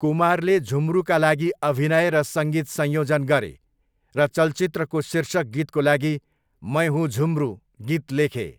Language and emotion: Nepali, neutral